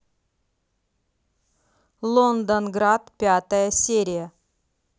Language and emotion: Russian, neutral